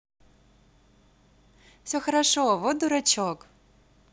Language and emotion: Russian, positive